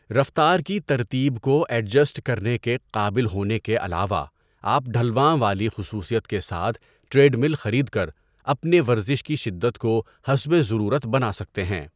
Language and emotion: Urdu, neutral